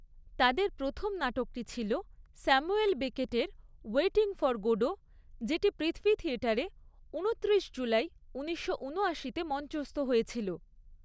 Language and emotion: Bengali, neutral